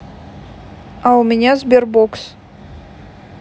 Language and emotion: Russian, neutral